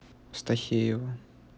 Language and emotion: Russian, neutral